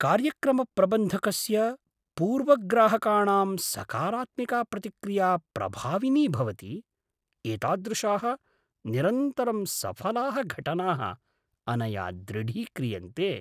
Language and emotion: Sanskrit, surprised